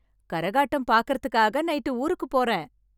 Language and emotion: Tamil, happy